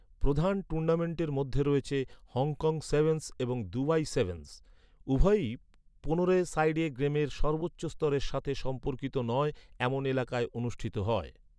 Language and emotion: Bengali, neutral